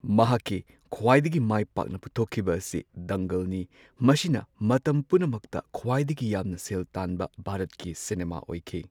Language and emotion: Manipuri, neutral